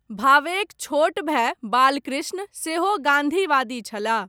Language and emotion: Maithili, neutral